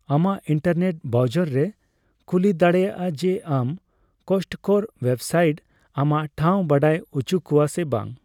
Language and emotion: Santali, neutral